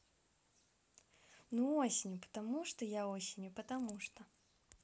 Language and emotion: Russian, neutral